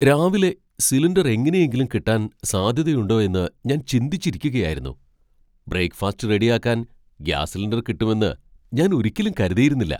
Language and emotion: Malayalam, surprised